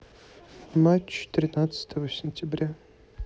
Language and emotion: Russian, neutral